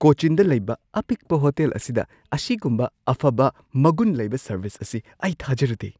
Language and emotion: Manipuri, surprised